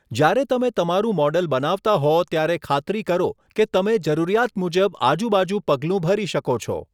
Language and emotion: Gujarati, neutral